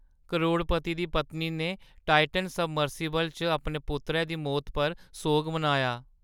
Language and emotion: Dogri, sad